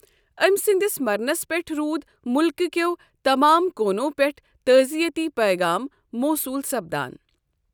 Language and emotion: Kashmiri, neutral